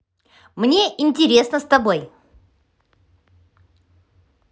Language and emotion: Russian, positive